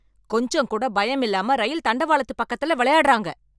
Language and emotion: Tamil, angry